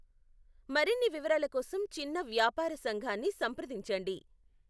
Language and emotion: Telugu, neutral